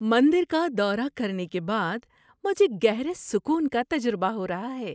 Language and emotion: Urdu, happy